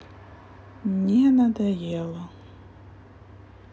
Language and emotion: Russian, sad